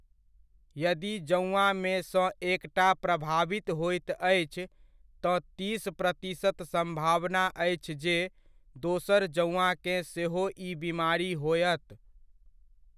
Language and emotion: Maithili, neutral